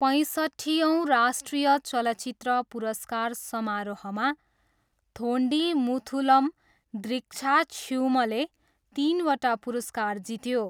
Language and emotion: Nepali, neutral